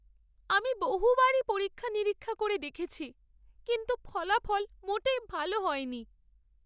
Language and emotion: Bengali, sad